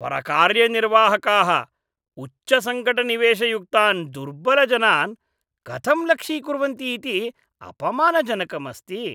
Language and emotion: Sanskrit, disgusted